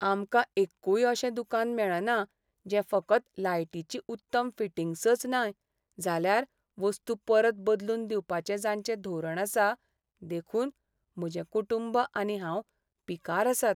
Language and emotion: Goan Konkani, sad